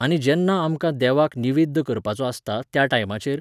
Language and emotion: Goan Konkani, neutral